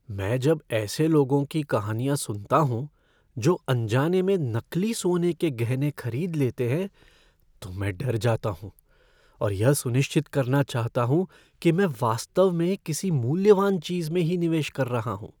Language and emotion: Hindi, fearful